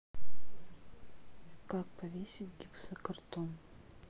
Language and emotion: Russian, neutral